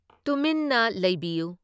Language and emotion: Manipuri, neutral